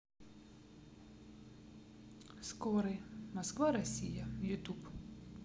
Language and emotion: Russian, neutral